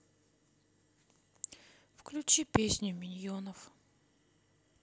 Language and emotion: Russian, sad